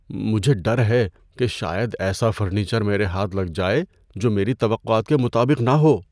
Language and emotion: Urdu, fearful